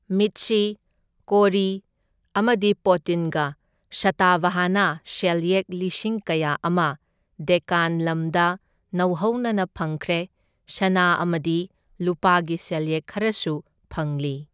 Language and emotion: Manipuri, neutral